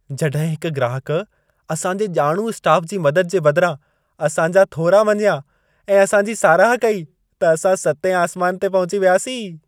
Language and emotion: Sindhi, happy